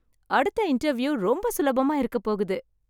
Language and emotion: Tamil, happy